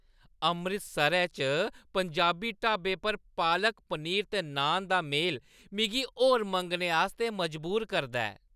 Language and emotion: Dogri, happy